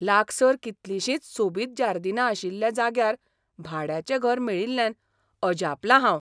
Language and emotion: Goan Konkani, surprised